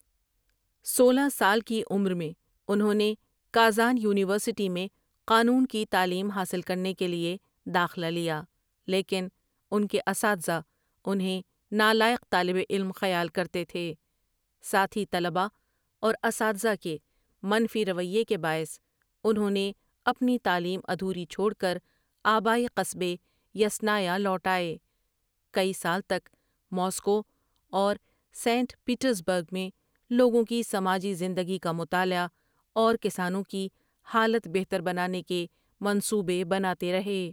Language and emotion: Urdu, neutral